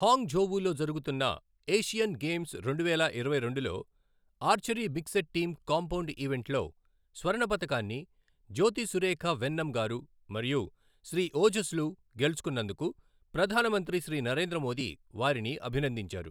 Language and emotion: Telugu, neutral